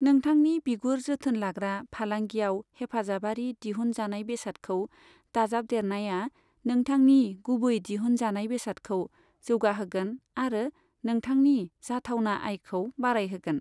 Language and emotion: Bodo, neutral